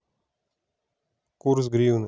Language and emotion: Russian, neutral